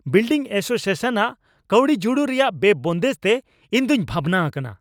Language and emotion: Santali, angry